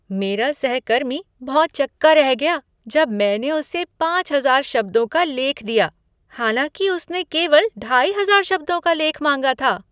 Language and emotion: Hindi, surprised